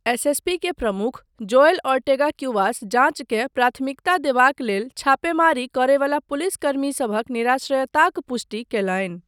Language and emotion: Maithili, neutral